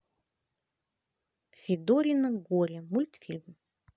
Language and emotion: Russian, positive